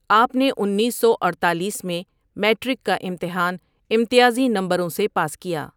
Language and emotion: Urdu, neutral